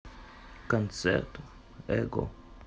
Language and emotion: Russian, neutral